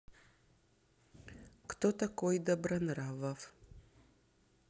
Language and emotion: Russian, neutral